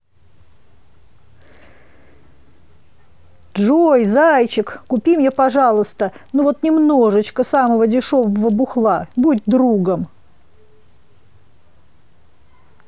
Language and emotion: Russian, positive